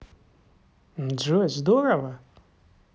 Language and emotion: Russian, positive